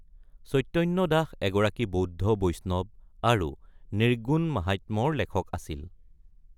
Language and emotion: Assamese, neutral